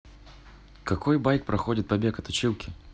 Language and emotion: Russian, neutral